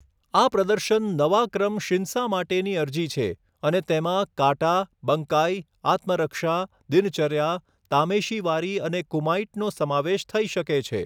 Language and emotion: Gujarati, neutral